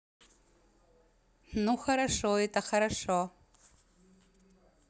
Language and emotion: Russian, positive